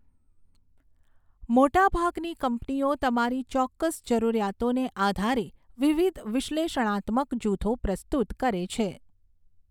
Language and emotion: Gujarati, neutral